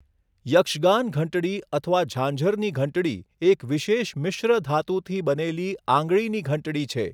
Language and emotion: Gujarati, neutral